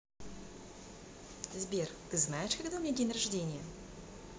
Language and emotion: Russian, positive